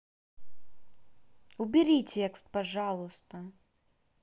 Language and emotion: Russian, angry